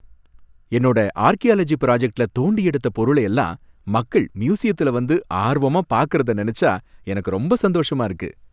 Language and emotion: Tamil, happy